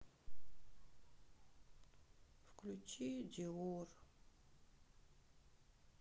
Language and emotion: Russian, sad